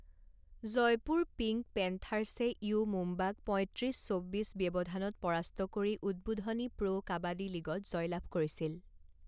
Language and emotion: Assamese, neutral